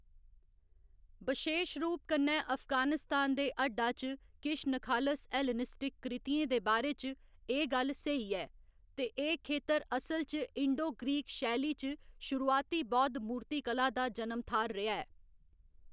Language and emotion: Dogri, neutral